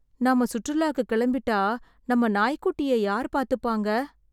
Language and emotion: Tamil, sad